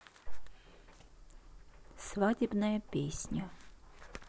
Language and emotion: Russian, neutral